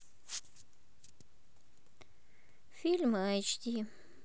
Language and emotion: Russian, sad